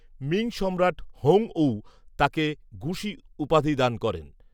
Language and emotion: Bengali, neutral